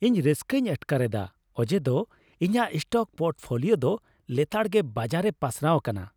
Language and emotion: Santali, happy